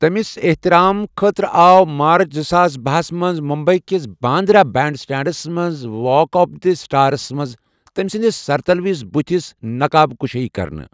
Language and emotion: Kashmiri, neutral